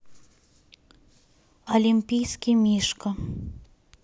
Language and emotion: Russian, neutral